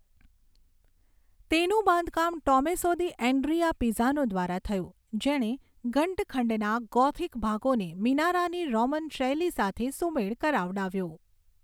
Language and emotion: Gujarati, neutral